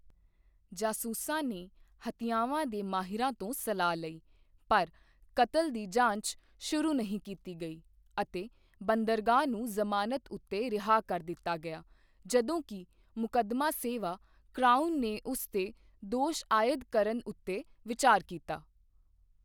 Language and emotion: Punjabi, neutral